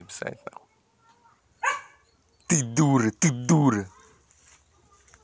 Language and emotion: Russian, angry